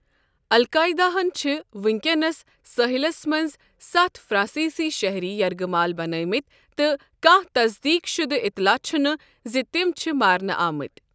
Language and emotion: Kashmiri, neutral